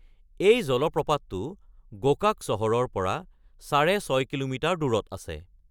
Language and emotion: Assamese, neutral